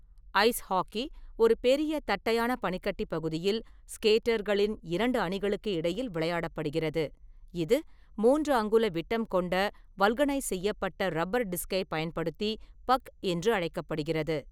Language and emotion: Tamil, neutral